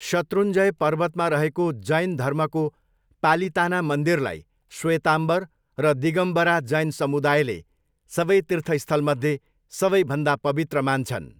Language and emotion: Nepali, neutral